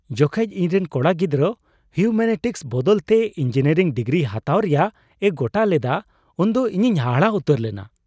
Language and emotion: Santali, surprised